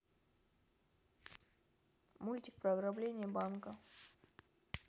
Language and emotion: Russian, neutral